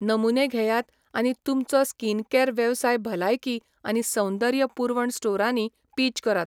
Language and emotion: Goan Konkani, neutral